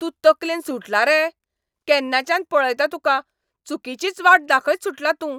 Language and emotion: Goan Konkani, angry